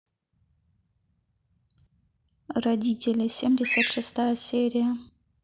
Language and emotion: Russian, neutral